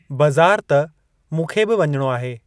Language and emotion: Sindhi, neutral